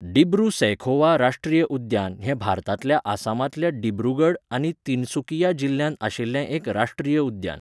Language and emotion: Goan Konkani, neutral